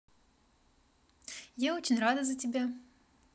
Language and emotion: Russian, positive